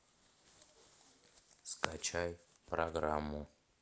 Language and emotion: Russian, neutral